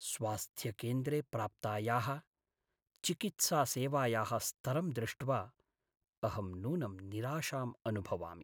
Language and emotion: Sanskrit, sad